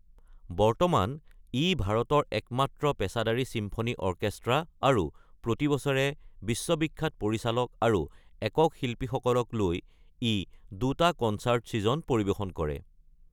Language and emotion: Assamese, neutral